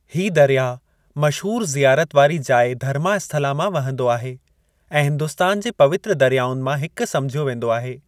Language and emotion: Sindhi, neutral